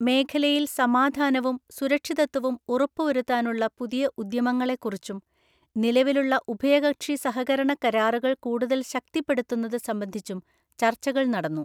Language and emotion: Malayalam, neutral